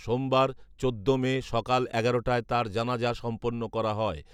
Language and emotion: Bengali, neutral